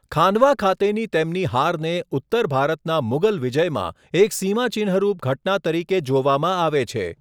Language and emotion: Gujarati, neutral